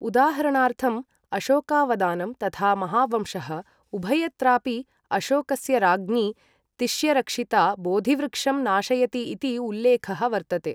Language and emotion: Sanskrit, neutral